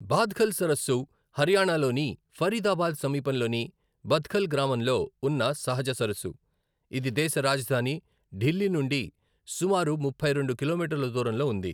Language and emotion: Telugu, neutral